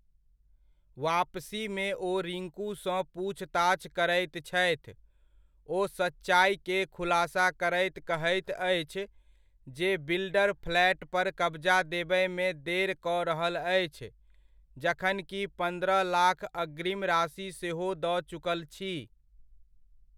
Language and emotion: Maithili, neutral